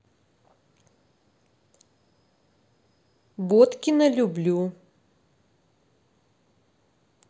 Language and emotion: Russian, neutral